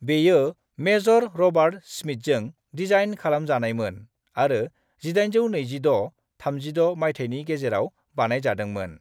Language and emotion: Bodo, neutral